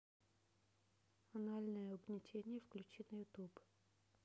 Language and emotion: Russian, neutral